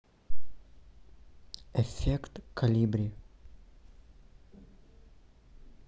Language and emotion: Russian, neutral